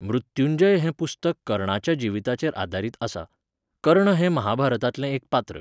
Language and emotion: Goan Konkani, neutral